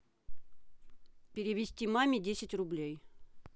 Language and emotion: Russian, neutral